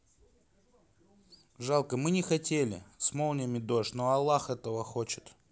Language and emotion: Russian, neutral